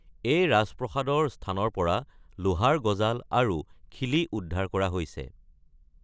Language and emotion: Assamese, neutral